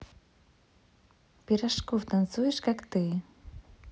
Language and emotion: Russian, neutral